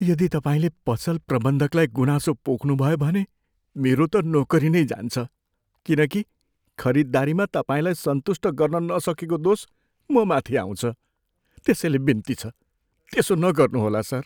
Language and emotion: Nepali, fearful